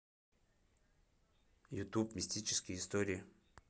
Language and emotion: Russian, neutral